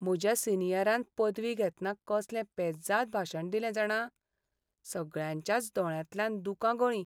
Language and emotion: Goan Konkani, sad